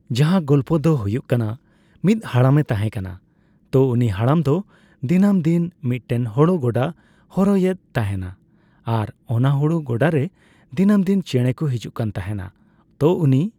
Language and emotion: Santali, neutral